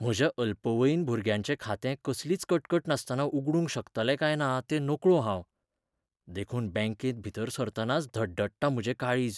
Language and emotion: Goan Konkani, fearful